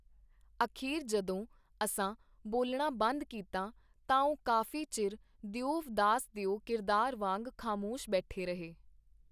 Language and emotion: Punjabi, neutral